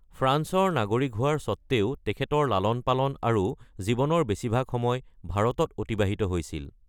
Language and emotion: Assamese, neutral